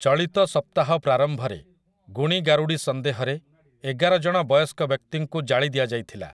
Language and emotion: Odia, neutral